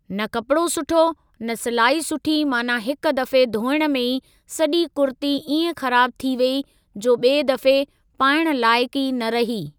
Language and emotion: Sindhi, neutral